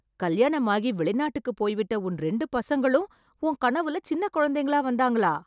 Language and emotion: Tamil, surprised